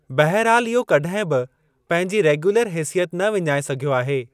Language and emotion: Sindhi, neutral